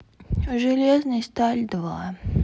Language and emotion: Russian, sad